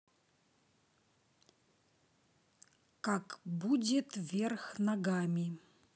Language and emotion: Russian, neutral